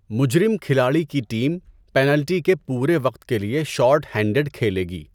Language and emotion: Urdu, neutral